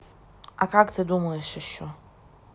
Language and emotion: Russian, neutral